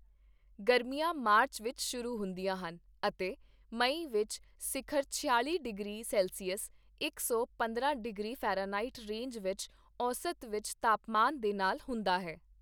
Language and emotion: Punjabi, neutral